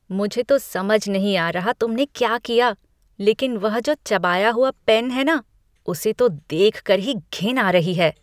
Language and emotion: Hindi, disgusted